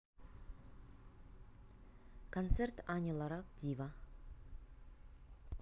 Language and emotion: Russian, neutral